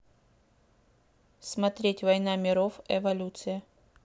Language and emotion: Russian, neutral